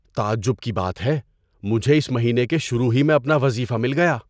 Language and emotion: Urdu, surprised